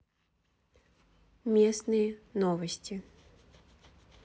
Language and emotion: Russian, neutral